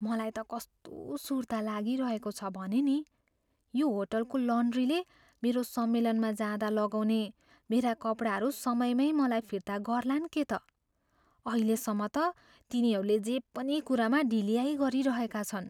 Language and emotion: Nepali, fearful